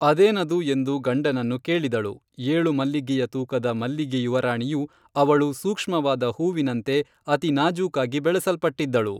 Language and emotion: Kannada, neutral